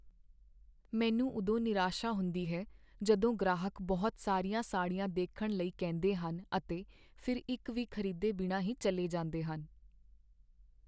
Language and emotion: Punjabi, sad